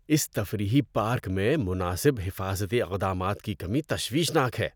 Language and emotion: Urdu, disgusted